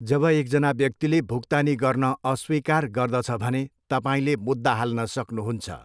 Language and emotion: Nepali, neutral